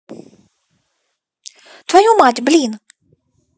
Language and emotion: Russian, angry